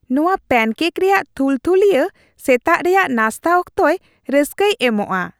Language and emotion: Santali, happy